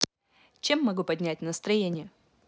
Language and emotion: Russian, positive